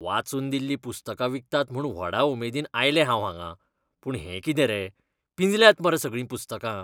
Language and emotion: Goan Konkani, disgusted